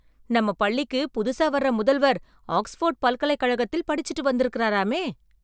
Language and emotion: Tamil, surprised